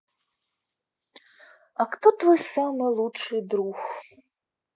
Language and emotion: Russian, neutral